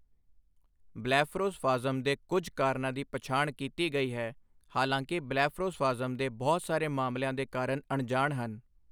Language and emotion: Punjabi, neutral